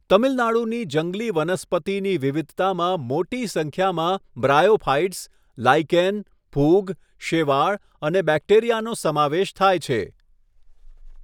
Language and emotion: Gujarati, neutral